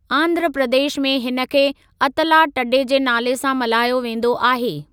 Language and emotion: Sindhi, neutral